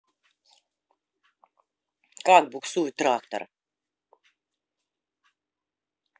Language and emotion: Russian, neutral